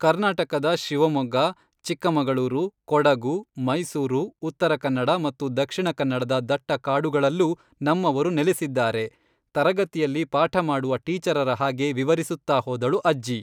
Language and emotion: Kannada, neutral